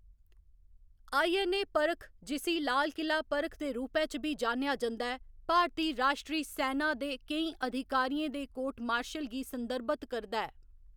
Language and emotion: Dogri, neutral